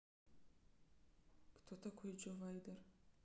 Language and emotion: Russian, neutral